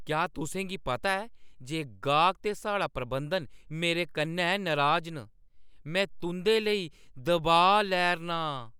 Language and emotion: Dogri, angry